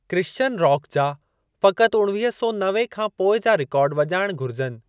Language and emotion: Sindhi, neutral